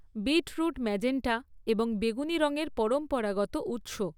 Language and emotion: Bengali, neutral